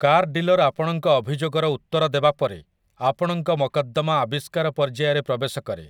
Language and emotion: Odia, neutral